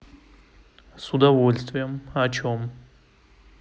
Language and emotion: Russian, neutral